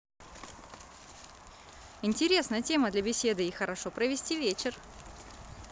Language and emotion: Russian, positive